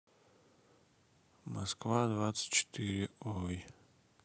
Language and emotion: Russian, sad